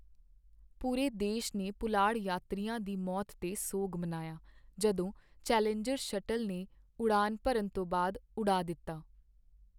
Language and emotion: Punjabi, sad